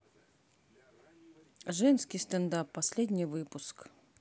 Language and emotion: Russian, neutral